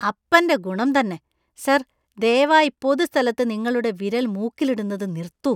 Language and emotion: Malayalam, disgusted